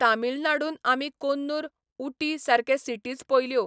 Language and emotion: Goan Konkani, neutral